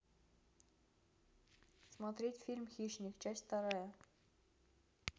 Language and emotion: Russian, neutral